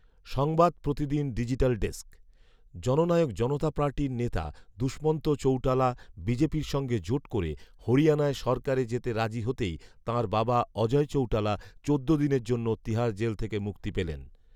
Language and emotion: Bengali, neutral